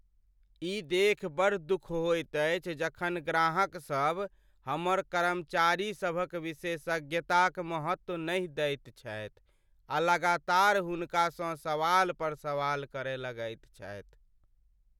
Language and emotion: Maithili, sad